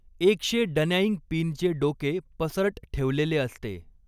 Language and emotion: Marathi, neutral